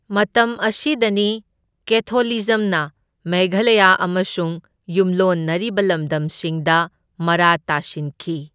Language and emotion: Manipuri, neutral